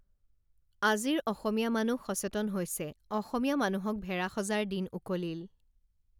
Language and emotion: Assamese, neutral